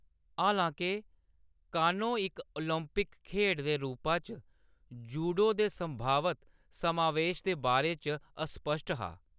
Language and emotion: Dogri, neutral